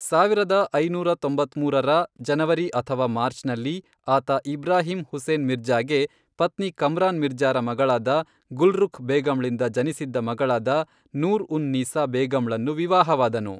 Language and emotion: Kannada, neutral